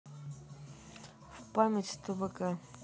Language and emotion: Russian, neutral